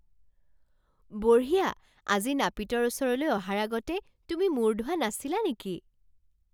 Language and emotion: Assamese, surprised